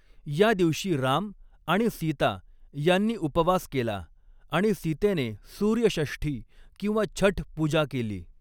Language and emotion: Marathi, neutral